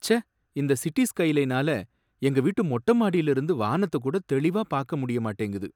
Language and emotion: Tamil, sad